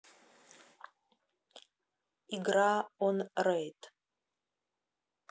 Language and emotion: Russian, neutral